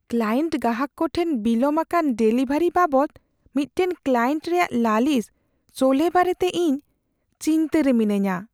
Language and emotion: Santali, fearful